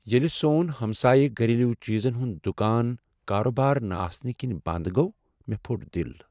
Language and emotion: Kashmiri, sad